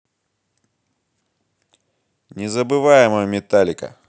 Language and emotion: Russian, positive